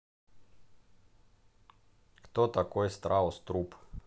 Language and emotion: Russian, neutral